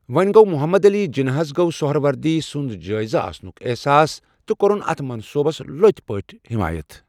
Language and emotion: Kashmiri, neutral